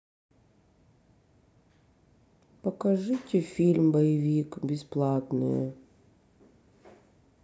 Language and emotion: Russian, sad